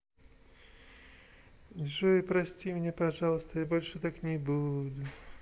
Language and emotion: Russian, sad